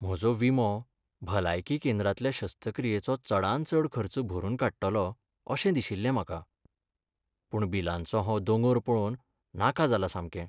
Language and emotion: Goan Konkani, sad